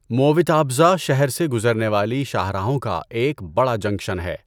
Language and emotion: Urdu, neutral